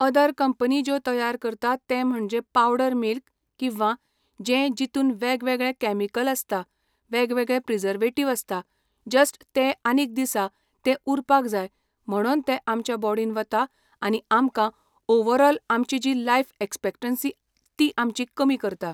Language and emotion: Goan Konkani, neutral